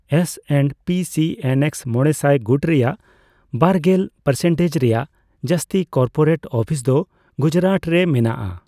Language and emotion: Santali, neutral